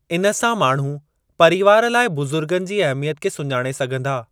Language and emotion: Sindhi, neutral